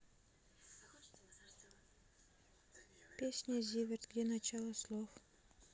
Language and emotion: Russian, sad